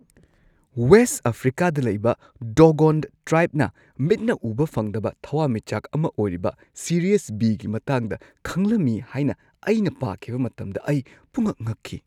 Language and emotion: Manipuri, surprised